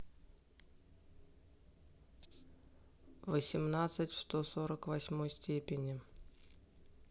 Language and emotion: Russian, neutral